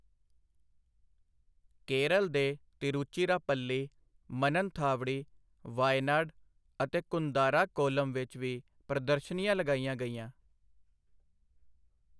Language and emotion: Punjabi, neutral